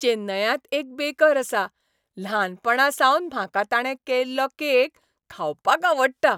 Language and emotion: Goan Konkani, happy